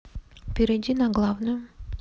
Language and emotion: Russian, neutral